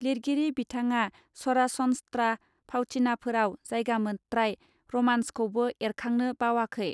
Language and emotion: Bodo, neutral